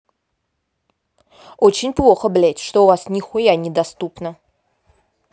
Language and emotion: Russian, angry